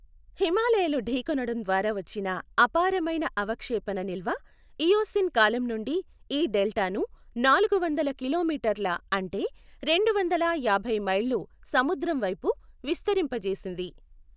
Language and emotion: Telugu, neutral